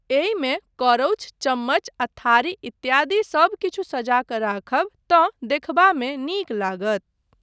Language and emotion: Maithili, neutral